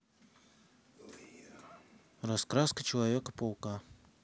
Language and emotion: Russian, neutral